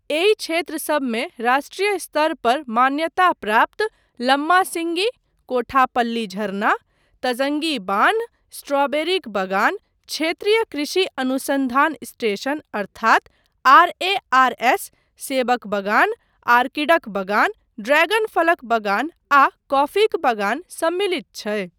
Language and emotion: Maithili, neutral